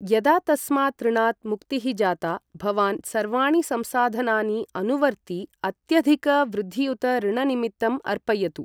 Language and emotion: Sanskrit, neutral